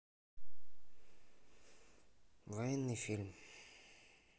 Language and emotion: Russian, sad